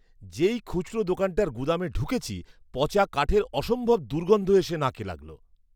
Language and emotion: Bengali, disgusted